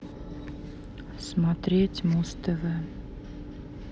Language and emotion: Russian, sad